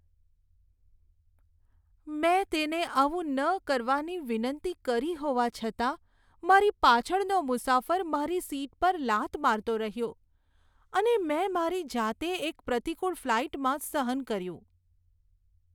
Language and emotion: Gujarati, sad